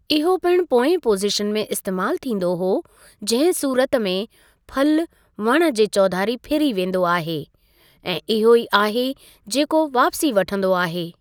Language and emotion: Sindhi, neutral